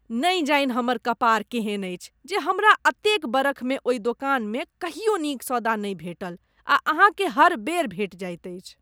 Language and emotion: Maithili, disgusted